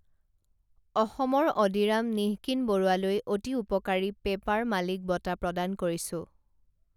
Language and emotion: Assamese, neutral